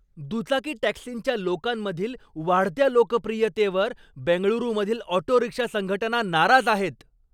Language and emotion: Marathi, angry